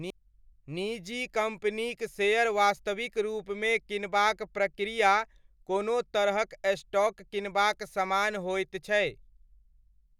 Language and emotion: Maithili, neutral